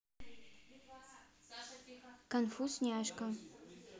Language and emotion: Russian, neutral